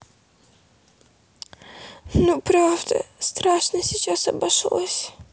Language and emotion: Russian, sad